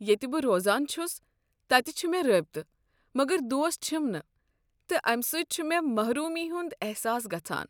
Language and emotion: Kashmiri, sad